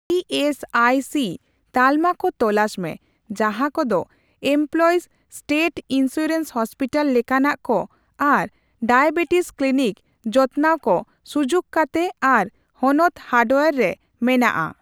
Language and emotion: Santali, neutral